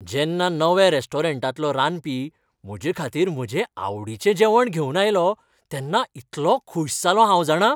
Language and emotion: Goan Konkani, happy